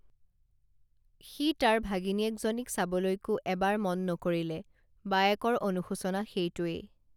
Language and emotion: Assamese, neutral